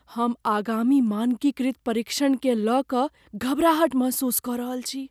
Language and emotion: Maithili, fearful